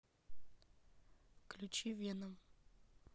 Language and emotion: Russian, neutral